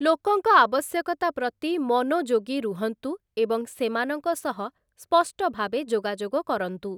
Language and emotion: Odia, neutral